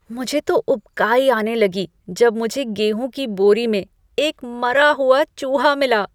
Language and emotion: Hindi, disgusted